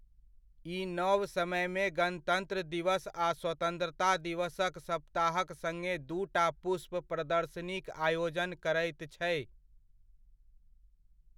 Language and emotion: Maithili, neutral